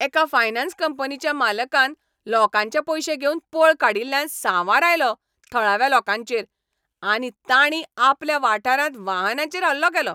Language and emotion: Goan Konkani, angry